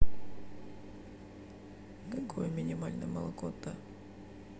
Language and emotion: Russian, neutral